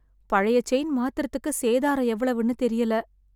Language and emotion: Tamil, sad